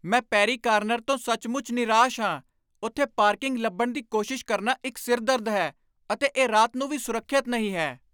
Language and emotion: Punjabi, angry